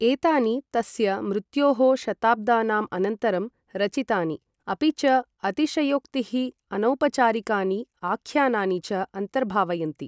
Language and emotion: Sanskrit, neutral